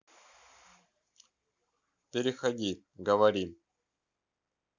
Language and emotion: Russian, neutral